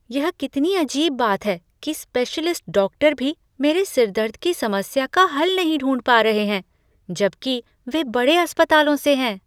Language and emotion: Hindi, surprised